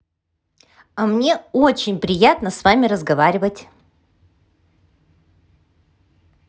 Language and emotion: Russian, positive